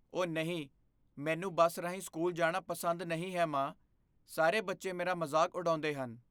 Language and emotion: Punjabi, fearful